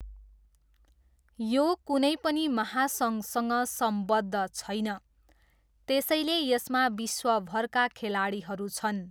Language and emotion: Nepali, neutral